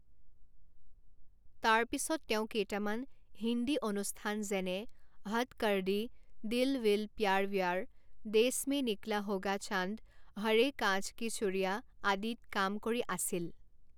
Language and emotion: Assamese, neutral